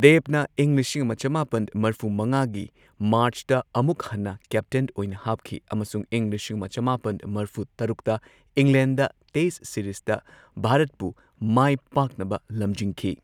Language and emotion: Manipuri, neutral